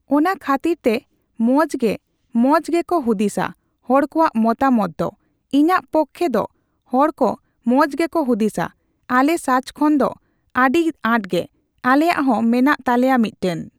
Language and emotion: Santali, neutral